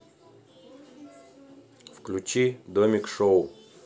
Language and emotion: Russian, neutral